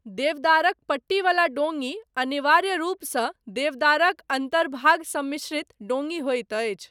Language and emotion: Maithili, neutral